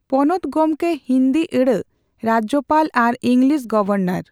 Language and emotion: Santali, neutral